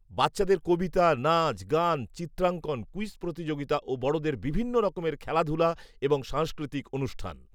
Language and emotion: Bengali, neutral